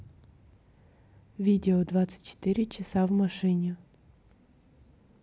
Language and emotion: Russian, neutral